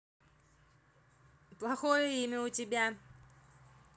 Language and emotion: Russian, neutral